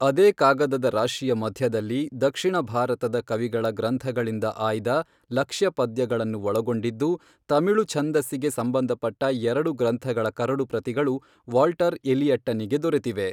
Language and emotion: Kannada, neutral